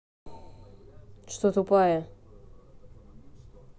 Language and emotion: Russian, angry